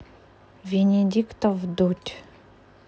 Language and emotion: Russian, neutral